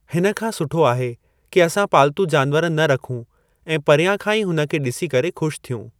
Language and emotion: Sindhi, neutral